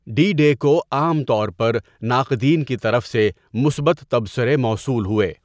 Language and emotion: Urdu, neutral